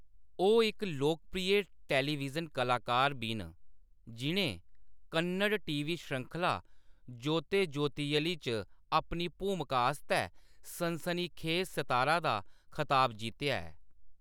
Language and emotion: Dogri, neutral